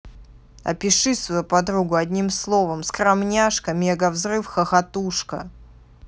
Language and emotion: Russian, neutral